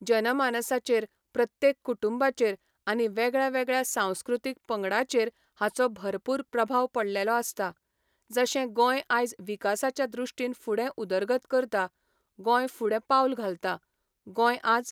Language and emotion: Goan Konkani, neutral